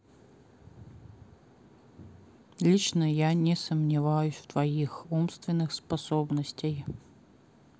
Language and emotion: Russian, neutral